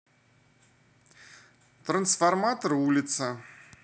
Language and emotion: Russian, neutral